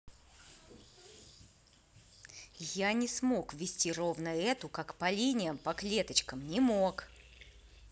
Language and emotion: Russian, angry